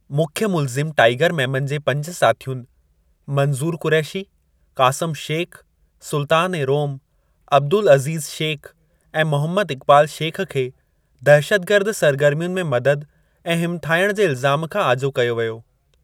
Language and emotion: Sindhi, neutral